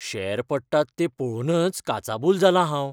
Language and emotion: Goan Konkani, fearful